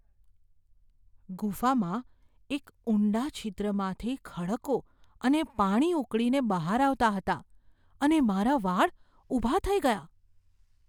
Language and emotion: Gujarati, fearful